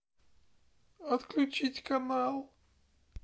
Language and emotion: Russian, sad